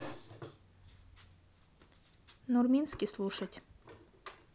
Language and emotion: Russian, neutral